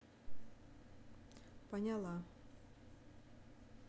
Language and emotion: Russian, neutral